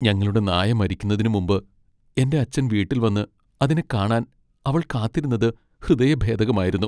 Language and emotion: Malayalam, sad